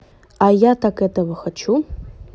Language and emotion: Russian, neutral